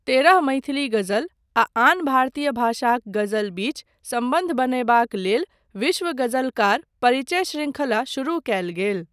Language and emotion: Maithili, neutral